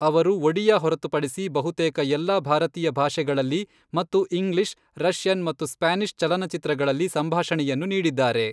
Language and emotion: Kannada, neutral